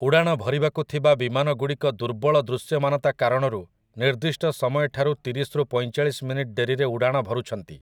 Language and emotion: Odia, neutral